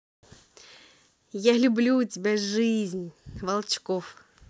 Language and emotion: Russian, positive